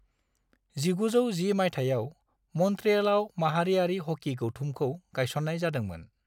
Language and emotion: Bodo, neutral